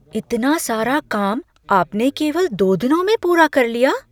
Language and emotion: Hindi, surprised